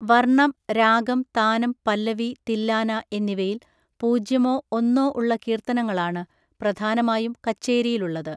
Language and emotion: Malayalam, neutral